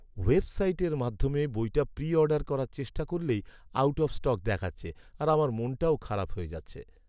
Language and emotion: Bengali, sad